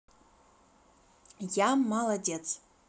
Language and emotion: Russian, positive